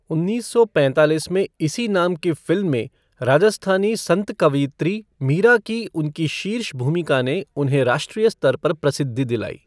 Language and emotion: Hindi, neutral